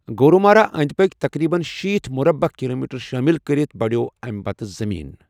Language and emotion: Kashmiri, neutral